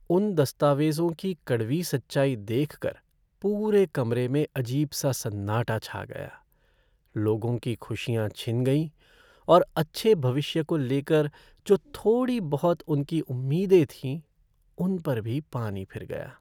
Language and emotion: Hindi, sad